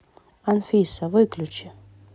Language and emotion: Russian, neutral